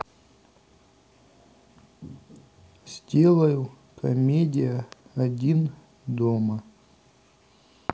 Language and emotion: Russian, neutral